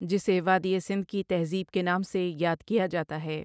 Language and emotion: Urdu, neutral